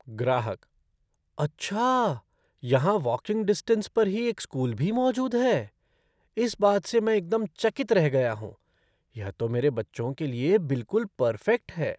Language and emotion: Hindi, surprised